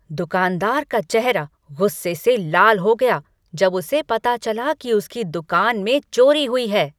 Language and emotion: Hindi, angry